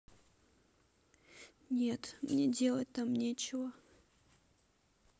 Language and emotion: Russian, sad